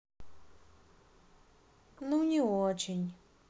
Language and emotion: Russian, sad